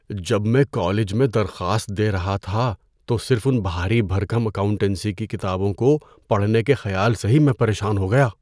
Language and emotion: Urdu, fearful